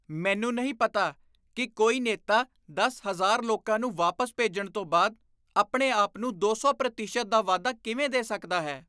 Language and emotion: Punjabi, disgusted